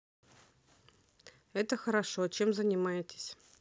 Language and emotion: Russian, neutral